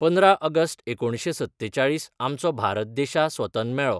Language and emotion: Goan Konkani, neutral